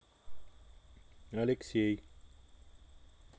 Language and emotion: Russian, neutral